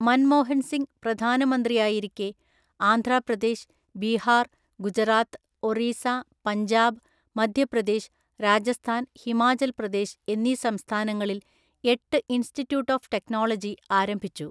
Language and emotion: Malayalam, neutral